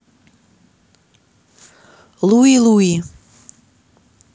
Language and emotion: Russian, neutral